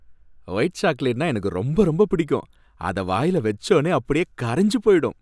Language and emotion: Tamil, happy